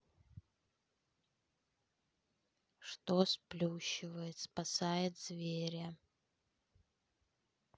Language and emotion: Russian, neutral